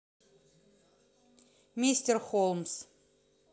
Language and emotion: Russian, neutral